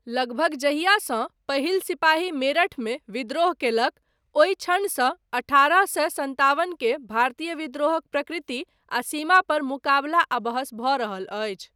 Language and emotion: Maithili, neutral